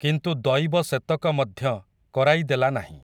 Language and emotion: Odia, neutral